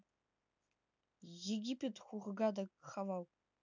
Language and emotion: Russian, neutral